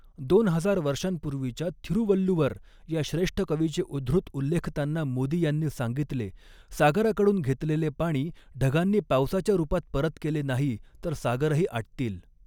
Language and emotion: Marathi, neutral